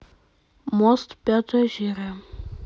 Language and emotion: Russian, neutral